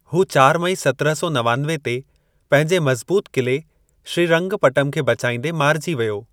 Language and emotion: Sindhi, neutral